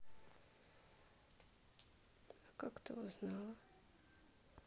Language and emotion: Russian, sad